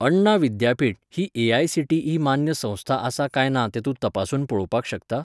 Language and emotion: Goan Konkani, neutral